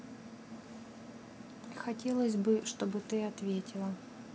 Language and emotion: Russian, neutral